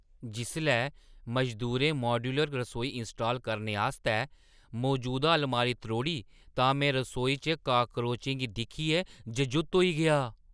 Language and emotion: Dogri, surprised